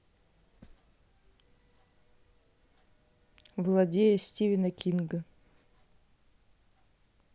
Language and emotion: Russian, neutral